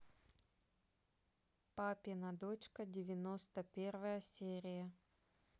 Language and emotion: Russian, neutral